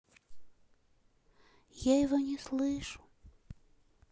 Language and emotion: Russian, sad